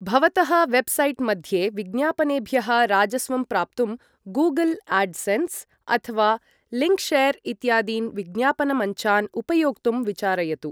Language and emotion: Sanskrit, neutral